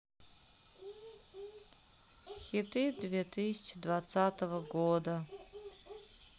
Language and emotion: Russian, sad